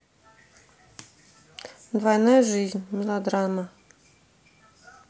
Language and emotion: Russian, neutral